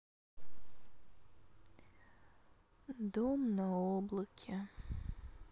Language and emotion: Russian, sad